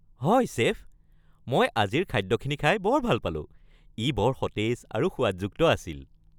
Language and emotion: Assamese, happy